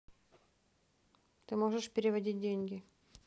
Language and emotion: Russian, neutral